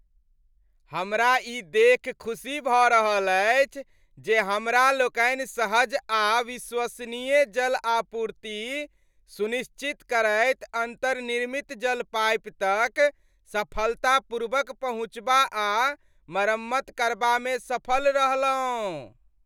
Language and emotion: Maithili, happy